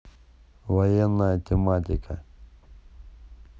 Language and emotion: Russian, neutral